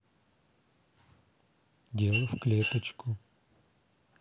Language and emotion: Russian, neutral